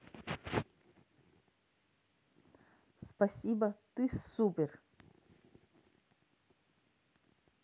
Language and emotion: Russian, positive